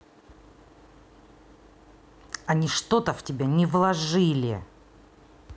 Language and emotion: Russian, angry